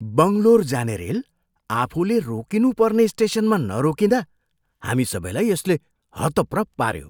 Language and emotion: Nepali, surprised